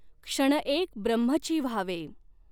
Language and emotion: Marathi, neutral